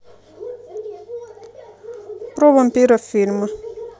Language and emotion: Russian, neutral